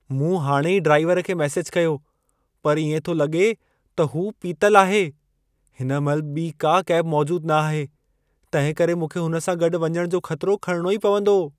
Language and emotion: Sindhi, fearful